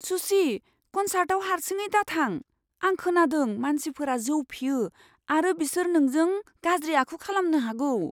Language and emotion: Bodo, fearful